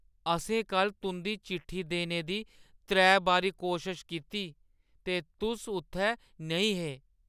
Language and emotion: Dogri, sad